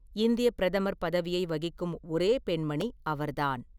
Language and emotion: Tamil, neutral